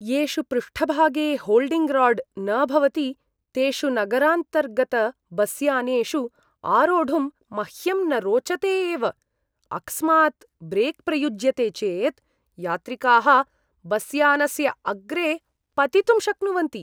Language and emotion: Sanskrit, disgusted